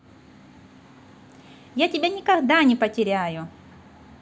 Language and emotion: Russian, positive